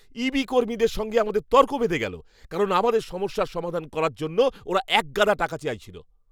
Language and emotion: Bengali, angry